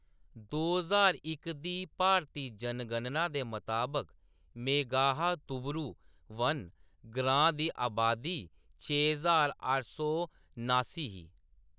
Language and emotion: Dogri, neutral